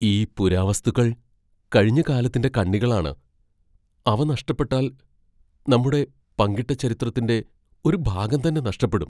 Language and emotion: Malayalam, fearful